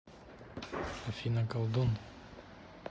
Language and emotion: Russian, neutral